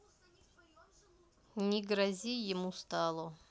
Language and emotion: Russian, neutral